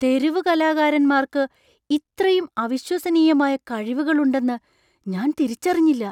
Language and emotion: Malayalam, surprised